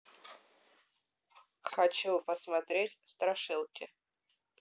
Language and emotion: Russian, neutral